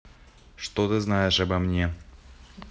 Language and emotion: Russian, neutral